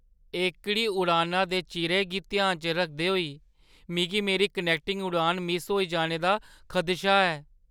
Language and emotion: Dogri, fearful